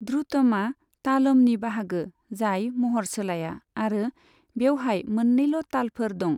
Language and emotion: Bodo, neutral